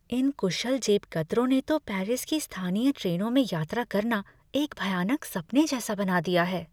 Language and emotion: Hindi, fearful